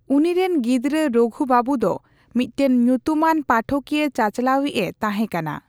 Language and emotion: Santali, neutral